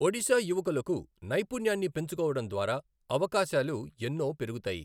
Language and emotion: Telugu, neutral